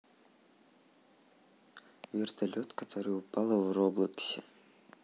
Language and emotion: Russian, neutral